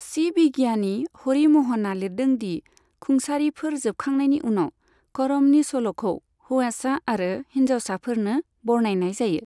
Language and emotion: Bodo, neutral